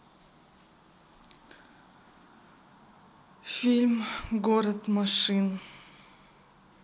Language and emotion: Russian, sad